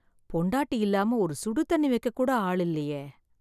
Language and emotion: Tamil, sad